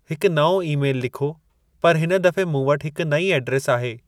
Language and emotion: Sindhi, neutral